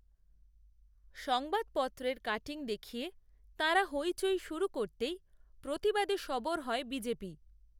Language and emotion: Bengali, neutral